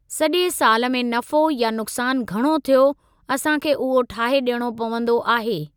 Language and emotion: Sindhi, neutral